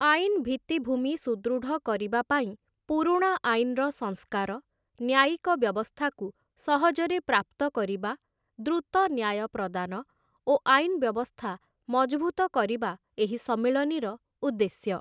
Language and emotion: Odia, neutral